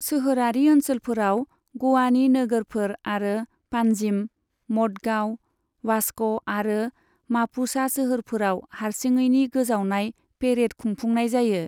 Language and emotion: Bodo, neutral